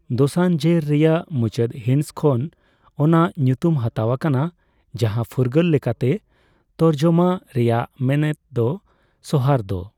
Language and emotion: Santali, neutral